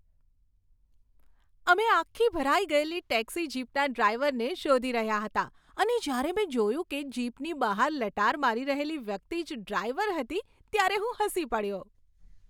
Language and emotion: Gujarati, happy